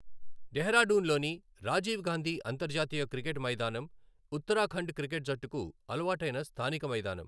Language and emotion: Telugu, neutral